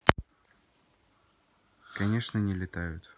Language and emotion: Russian, sad